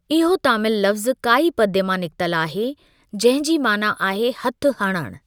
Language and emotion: Sindhi, neutral